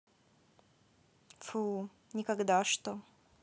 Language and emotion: Russian, neutral